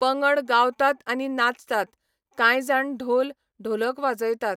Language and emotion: Goan Konkani, neutral